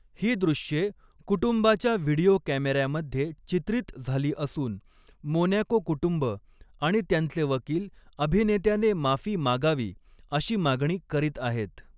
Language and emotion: Marathi, neutral